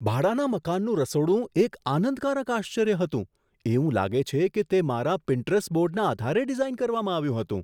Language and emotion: Gujarati, surprised